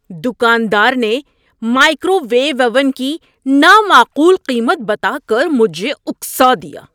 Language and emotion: Urdu, angry